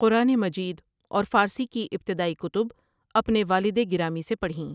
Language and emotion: Urdu, neutral